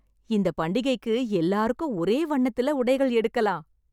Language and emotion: Tamil, happy